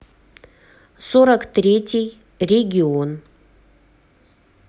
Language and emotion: Russian, neutral